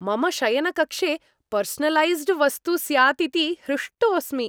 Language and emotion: Sanskrit, happy